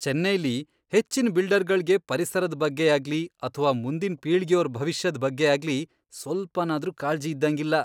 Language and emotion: Kannada, disgusted